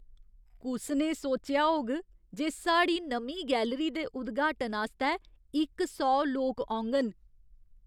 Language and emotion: Dogri, surprised